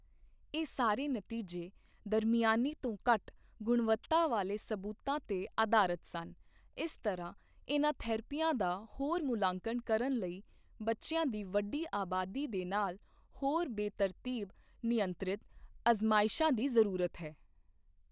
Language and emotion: Punjabi, neutral